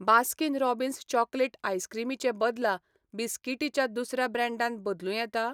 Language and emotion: Goan Konkani, neutral